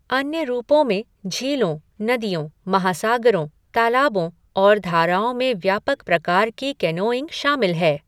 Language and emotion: Hindi, neutral